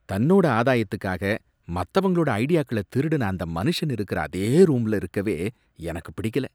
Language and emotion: Tamil, disgusted